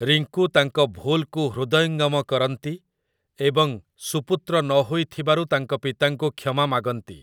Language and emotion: Odia, neutral